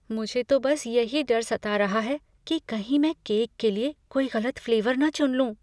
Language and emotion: Hindi, fearful